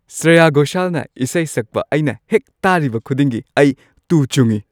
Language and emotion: Manipuri, happy